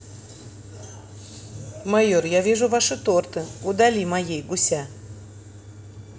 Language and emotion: Russian, neutral